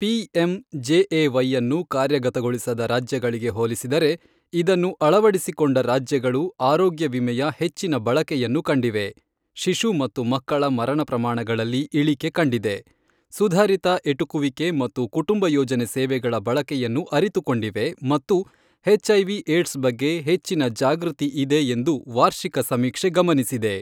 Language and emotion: Kannada, neutral